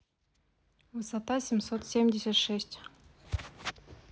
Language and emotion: Russian, neutral